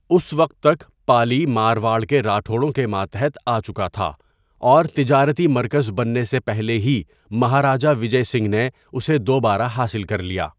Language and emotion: Urdu, neutral